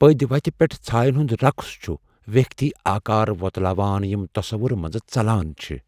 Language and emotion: Kashmiri, fearful